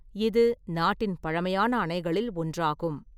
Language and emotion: Tamil, neutral